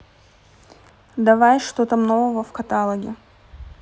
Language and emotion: Russian, neutral